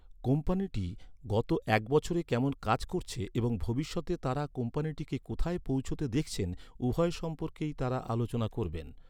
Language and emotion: Bengali, neutral